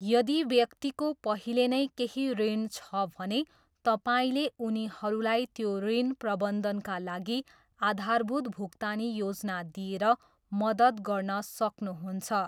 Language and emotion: Nepali, neutral